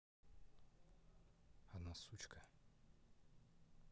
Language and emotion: Russian, neutral